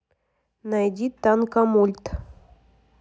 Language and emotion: Russian, neutral